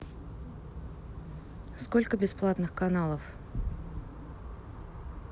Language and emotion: Russian, neutral